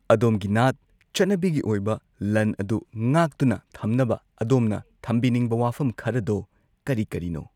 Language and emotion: Manipuri, neutral